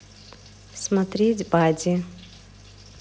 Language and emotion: Russian, neutral